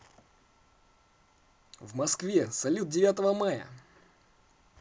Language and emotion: Russian, positive